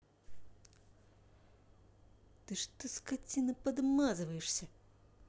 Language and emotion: Russian, angry